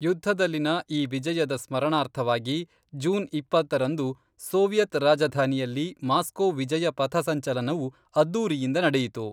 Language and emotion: Kannada, neutral